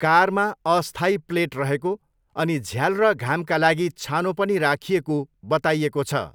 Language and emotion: Nepali, neutral